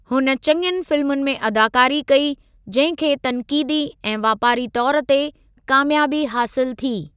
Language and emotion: Sindhi, neutral